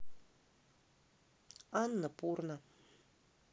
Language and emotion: Russian, neutral